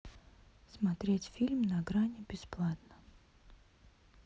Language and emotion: Russian, neutral